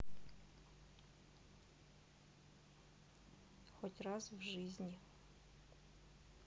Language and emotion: Russian, neutral